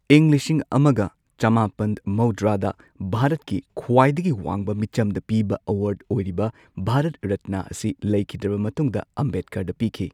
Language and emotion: Manipuri, neutral